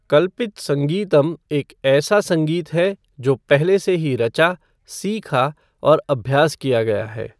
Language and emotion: Hindi, neutral